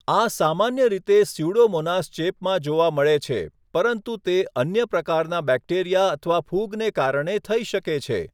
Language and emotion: Gujarati, neutral